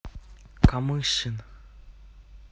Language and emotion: Russian, neutral